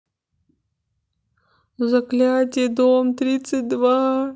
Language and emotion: Russian, sad